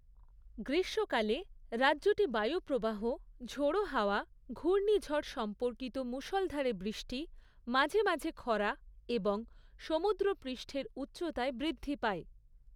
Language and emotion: Bengali, neutral